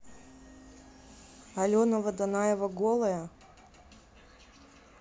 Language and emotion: Russian, neutral